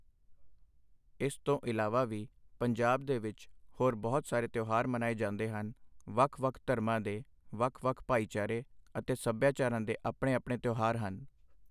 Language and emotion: Punjabi, neutral